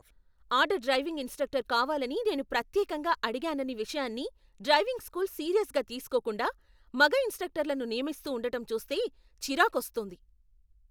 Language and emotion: Telugu, angry